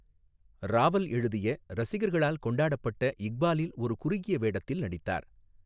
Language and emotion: Tamil, neutral